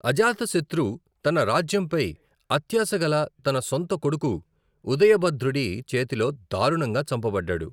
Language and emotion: Telugu, neutral